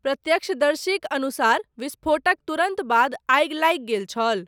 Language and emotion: Maithili, neutral